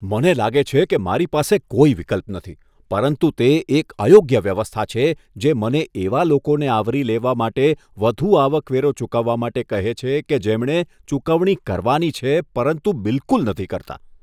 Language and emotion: Gujarati, disgusted